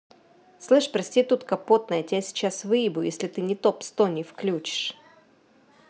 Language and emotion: Russian, angry